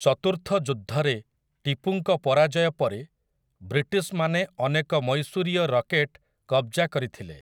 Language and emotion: Odia, neutral